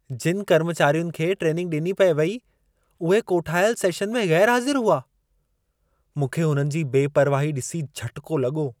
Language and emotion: Sindhi, surprised